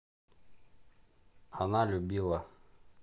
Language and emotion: Russian, neutral